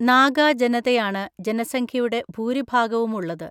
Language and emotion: Malayalam, neutral